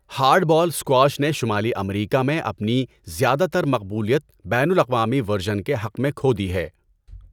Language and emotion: Urdu, neutral